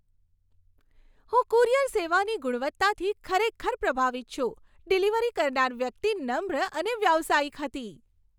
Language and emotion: Gujarati, happy